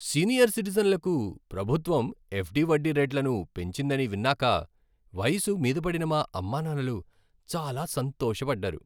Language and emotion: Telugu, happy